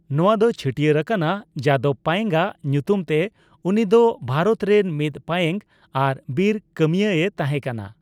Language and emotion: Santali, neutral